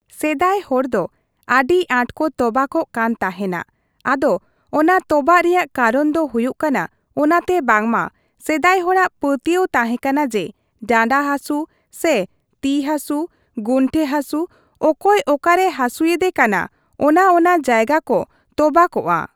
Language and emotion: Santali, neutral